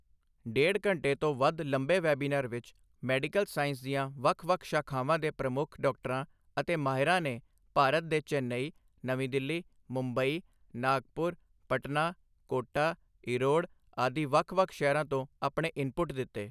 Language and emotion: Punjabi, neutral